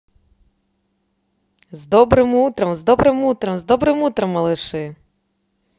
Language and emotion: Russian, positive